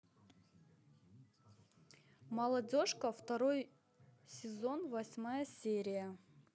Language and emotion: Russian, neutral